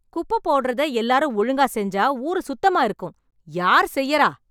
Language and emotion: Tamil, angry